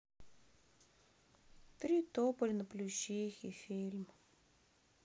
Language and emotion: Russian, sad